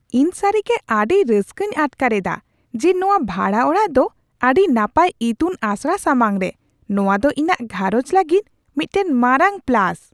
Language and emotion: Santali, surprised